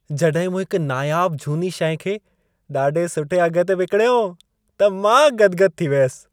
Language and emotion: Sindhi, happy